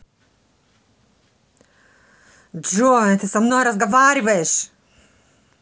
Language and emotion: Russian, angry